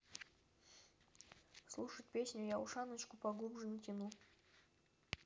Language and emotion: Russian, neutral